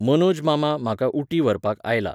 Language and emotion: Goan Konkani, neutral